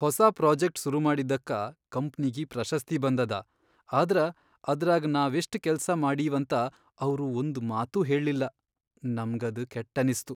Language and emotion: Kannada, sad